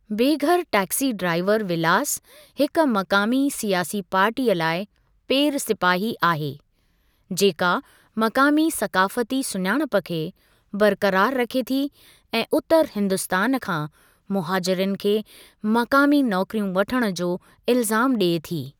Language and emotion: Sindhi, neutral